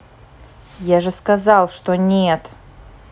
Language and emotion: Russian, angry